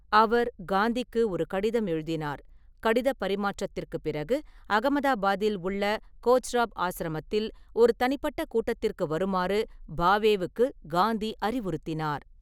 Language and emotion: Tamil, neutral